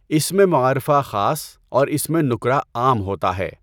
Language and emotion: Urdu, neutral